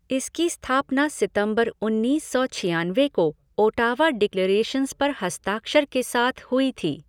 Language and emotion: Hindi, neutral